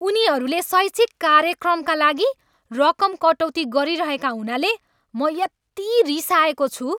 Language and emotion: Nepali, angry